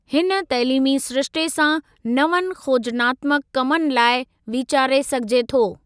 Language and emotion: Sindhi, neutral